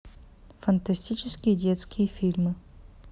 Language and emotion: Russian, neutral